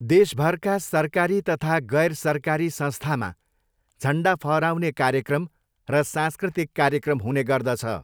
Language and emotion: Nepali, neutral